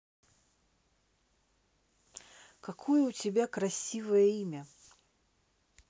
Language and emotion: Russian, neutral